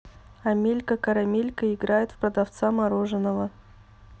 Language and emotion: Russian, neutral